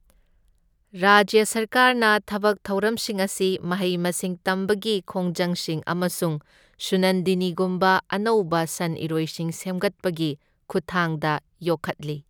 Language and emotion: Manipuri, neutral